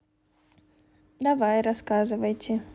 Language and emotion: Russian, neutral